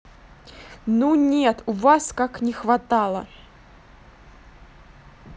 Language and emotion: Russian, angry